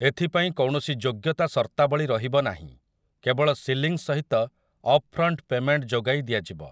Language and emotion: Odia, neutral